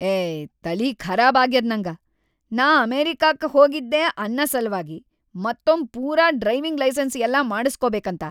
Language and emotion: Kannada, angry